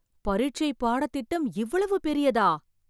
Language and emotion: Tamil, surprised